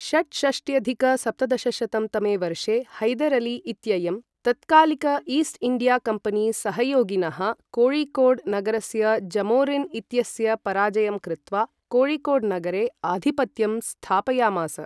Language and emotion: Sanskrit, neutral